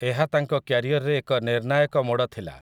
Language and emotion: Odia, neutral